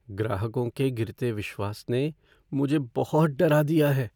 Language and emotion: Hindi, fearful